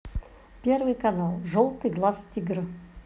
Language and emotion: Russian, positive